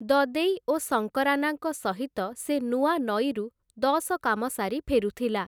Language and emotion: Odia, neutral